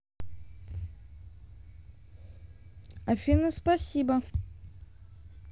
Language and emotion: Russian, neutral